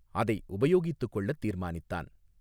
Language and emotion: Tamil, neutral